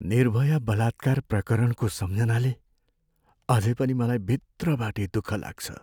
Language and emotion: Nepali, sad